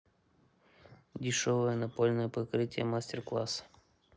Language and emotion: Russian, neutral